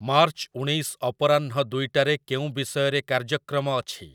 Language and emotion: Odia, neutral